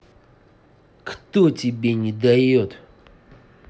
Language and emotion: Russian, angry